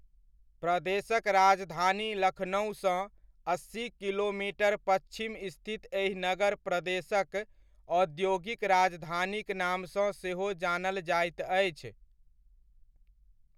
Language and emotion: Maithili, neutral